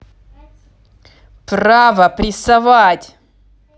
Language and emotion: Russian, angry